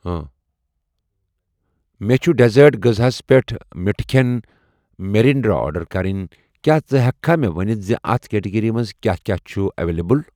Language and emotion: Kashmiri, neutral